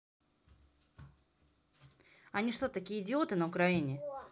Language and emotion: Russian, angry